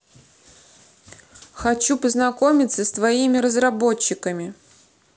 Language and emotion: Russian, neutral